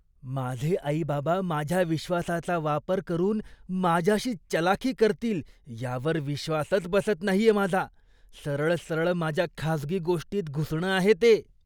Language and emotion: Marathi, disgusted